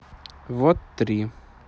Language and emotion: Russian, neutral